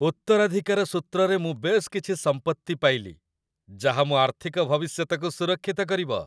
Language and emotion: Odia, happy